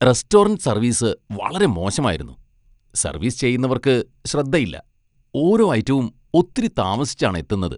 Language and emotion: Malayalam, disgusted